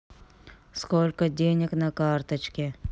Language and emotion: Russian, neutral